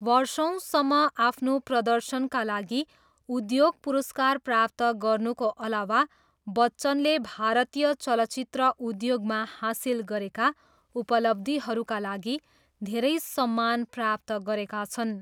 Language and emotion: Nepali, neutral